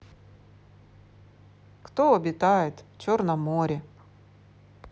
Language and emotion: Russian, neutral